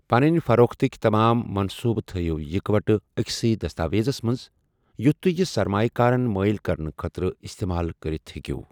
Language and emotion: Kashmiri, neutral